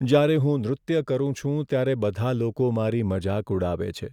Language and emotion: Gujarati, sad